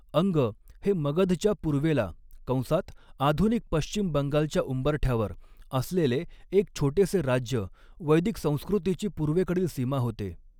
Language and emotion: Marathi, neutral